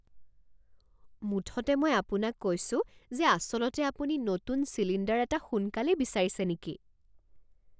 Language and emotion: Assamese, surprised